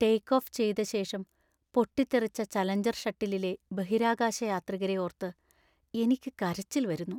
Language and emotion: Malayalam, sad